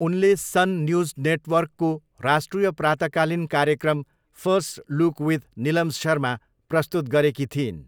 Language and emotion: Nepali, neutral